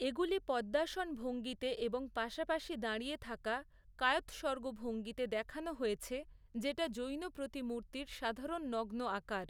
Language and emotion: Bengali, neutral